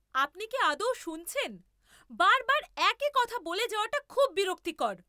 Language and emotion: Bengali, angry